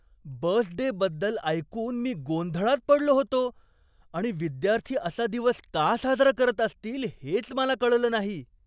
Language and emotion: Marathi, surprised